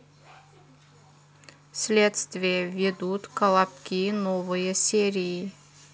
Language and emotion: Russian, neutral